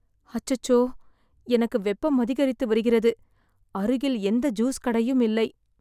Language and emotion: Tamil, sad